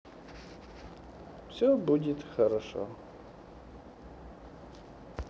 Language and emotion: Russian, neutral